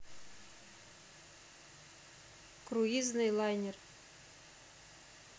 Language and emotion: Russian, neutral